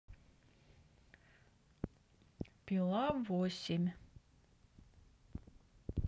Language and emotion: Russian, neutral